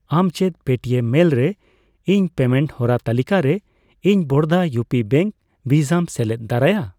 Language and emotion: Santali, neutral